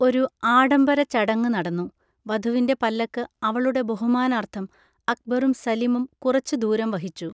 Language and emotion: Malayalam, neutral